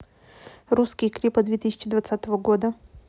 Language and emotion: Russian, neutral